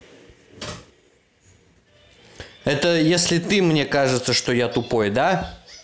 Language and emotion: Russian, angry